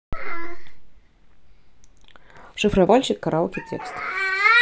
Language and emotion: Russian, neutral